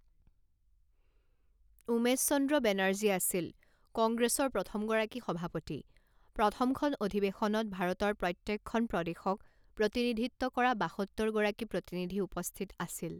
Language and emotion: Assamese, neutral